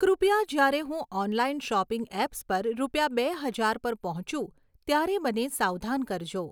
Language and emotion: Gujarati, neutral